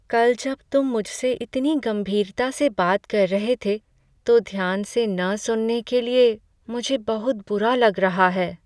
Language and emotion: Hindi, sad